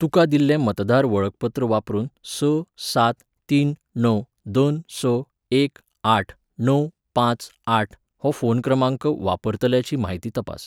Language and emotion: Goan Konkani, neutral